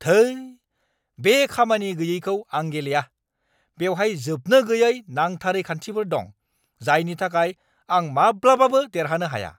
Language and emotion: Bodo, angry